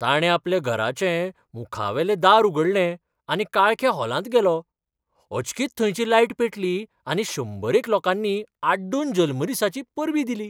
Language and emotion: Goan Konkani, surprised